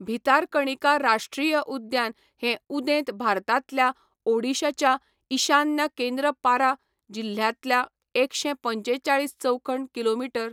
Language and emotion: Goan Konkani, neutral